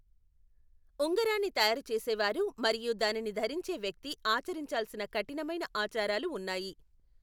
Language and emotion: Telugu, neutral